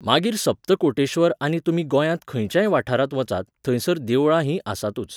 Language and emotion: Goan Konkani, neutral